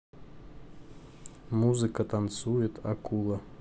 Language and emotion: Russian, neutral